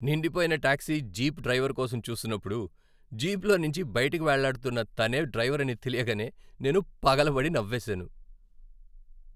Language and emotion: Telugu, happy